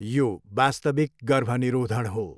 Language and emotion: Nepali, neutral